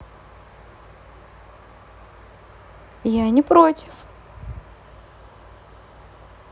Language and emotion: Russian, positive